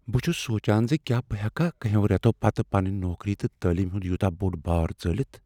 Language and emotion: Kashmiri, fearful